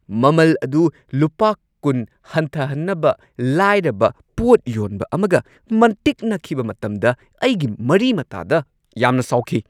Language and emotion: Manipuri, angry